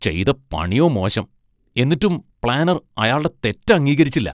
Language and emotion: Malayalam, disgusted